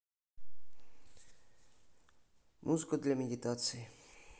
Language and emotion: Russian, neutral